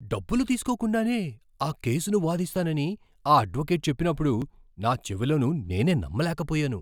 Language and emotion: Telugu, surprised